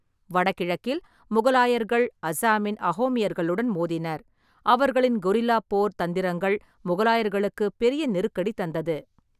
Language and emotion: Tamil, neutral